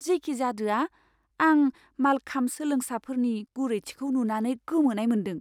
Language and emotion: Bodo, surprised